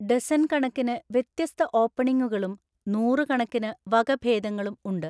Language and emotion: Malayalam, neutral